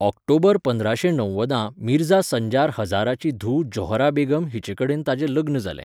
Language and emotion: Goan Konkani, neutral